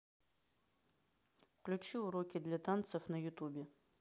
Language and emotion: Russian, neutral